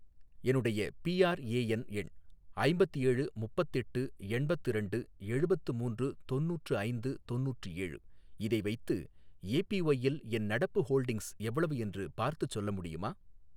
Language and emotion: Tamil, neutral